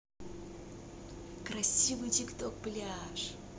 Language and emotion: Russian, positive